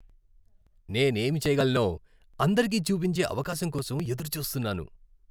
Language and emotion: Telugu, happy